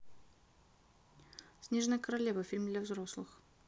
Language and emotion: Russian, neutral